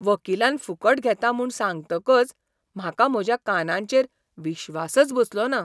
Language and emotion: Goan Konkani, surprised